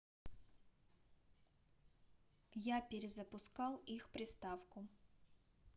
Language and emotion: Russian, neutral